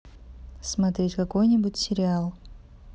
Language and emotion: Russian, neutral